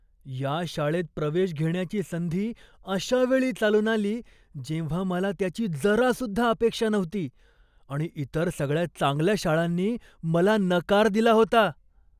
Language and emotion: Marathi, surprised